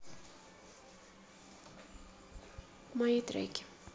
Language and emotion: Russian, sad